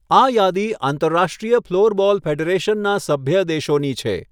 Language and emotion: Gujarati, neutral